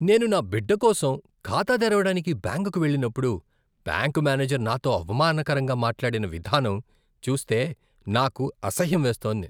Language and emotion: Telugu, disgusted